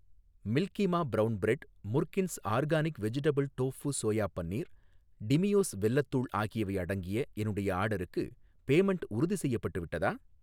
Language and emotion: Tamil, neutral